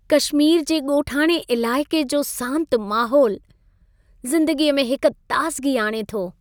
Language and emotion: Sindhi, happy